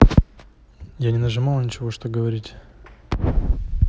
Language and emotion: Russian, neutral